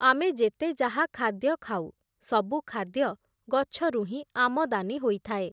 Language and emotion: Odia, neutral